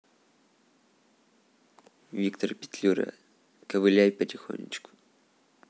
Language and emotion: Russian, neutral